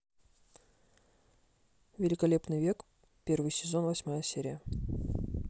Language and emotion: Russian, neutral